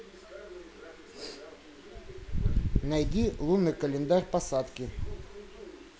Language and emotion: Russian, neutral